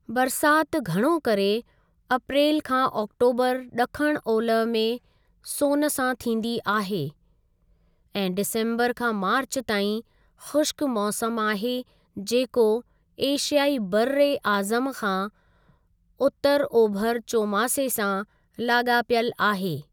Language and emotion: Sindhi, neutral